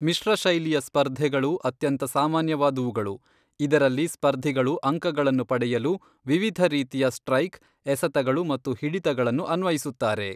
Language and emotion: Kannada, neutral